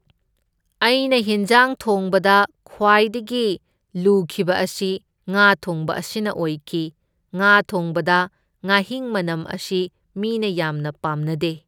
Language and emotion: Manipuri, neutral